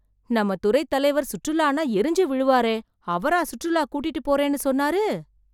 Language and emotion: Tamil, surprised